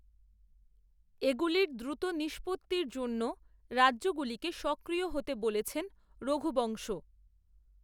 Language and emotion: Bengali, neutral